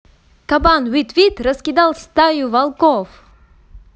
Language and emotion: Russian, positive